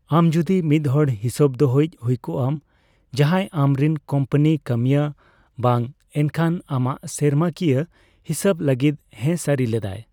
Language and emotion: Santali, neutral